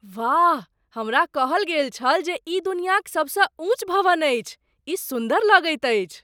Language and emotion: Maithili, surprised